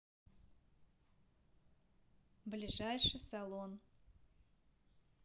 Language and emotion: Russian, neutral